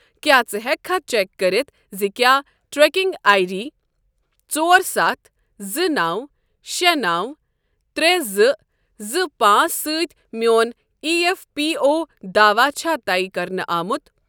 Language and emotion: Kashmiri, neutral